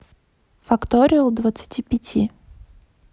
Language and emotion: Russian, neutral